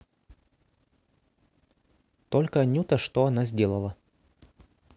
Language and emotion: Russian, neutral